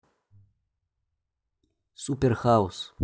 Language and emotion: Russian, neutral